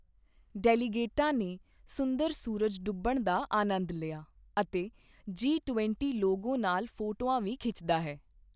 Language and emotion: Punjabi, neutral